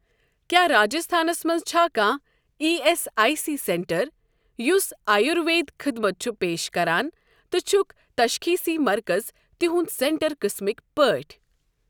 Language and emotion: Kashmiri, neutral